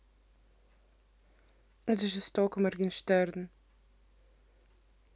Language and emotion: Russian, neutral